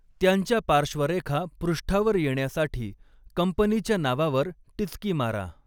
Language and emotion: Marathi, neutral